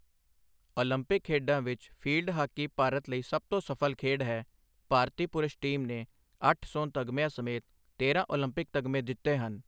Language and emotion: Punjabi, neutral